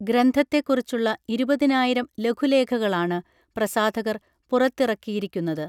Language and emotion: Malayalam, neutral